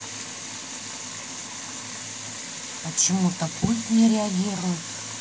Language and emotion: Russian, neutral